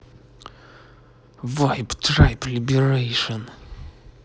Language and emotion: Russian, angry